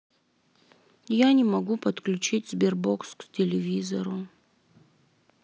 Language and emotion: Russian, sad